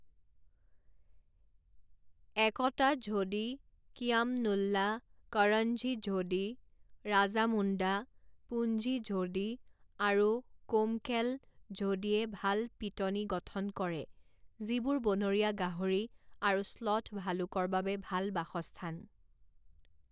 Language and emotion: Assamese, neutral